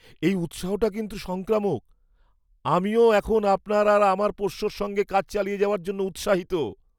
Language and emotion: Bengali, surprised